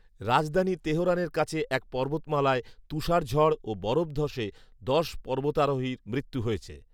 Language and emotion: Bengali, neutral